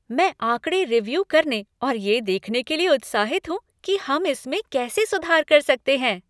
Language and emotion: Hindi, happy